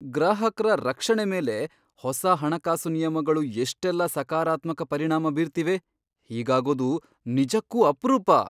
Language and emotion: Kannada, surprised